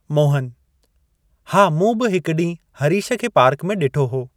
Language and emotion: Sindhi, neutral